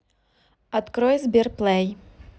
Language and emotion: Russian, neutral